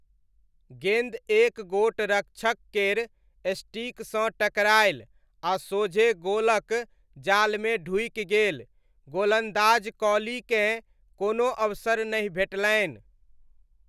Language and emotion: Maithili, neutral